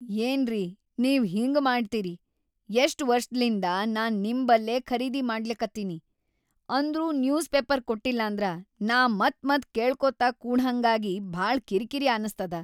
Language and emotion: Kannada, angry